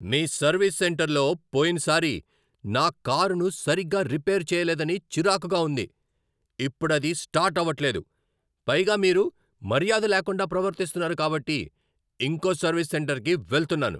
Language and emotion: Telugu, angry